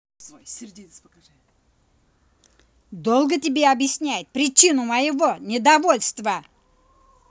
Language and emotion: Russian, angry